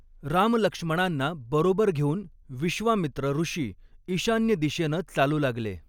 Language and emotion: Marathi, neutral